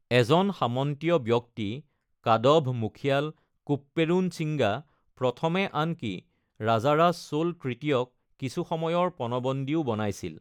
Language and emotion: Assamese, neutral